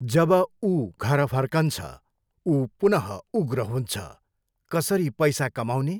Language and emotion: Nepali, neutral